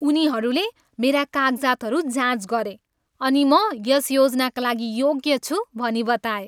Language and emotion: Nepali, happy